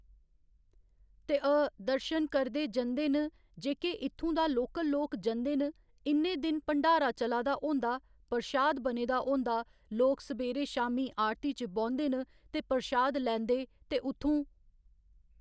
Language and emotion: Dogri, neutral